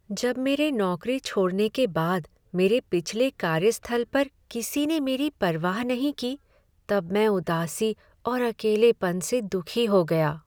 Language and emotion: Hindi, sad